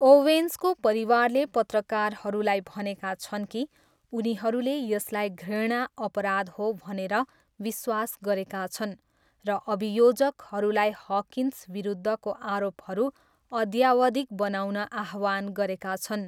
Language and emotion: Nepali, neutral